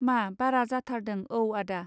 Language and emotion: Bodo, neutral